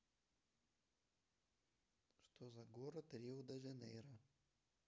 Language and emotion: Russian, neutral